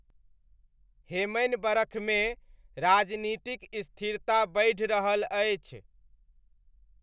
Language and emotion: Maithili, neutral